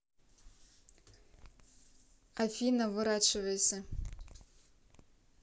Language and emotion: Russian, neutral